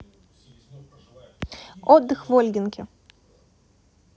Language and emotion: Russian, neutral